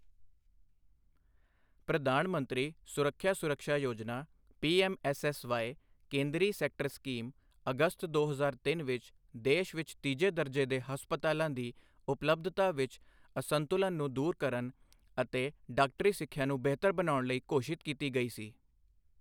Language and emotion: Punjabi, neutral